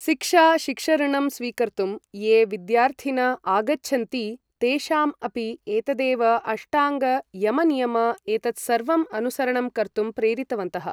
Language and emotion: Sanskrit, neutral